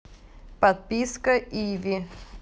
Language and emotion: Russian, neutral